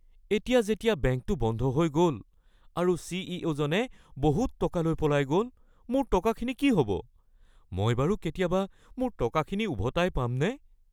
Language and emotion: Assamese, fearful